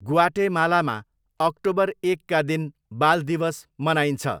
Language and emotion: Nepali, neutral